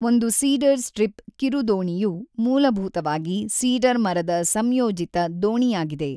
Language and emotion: Kannada, neutral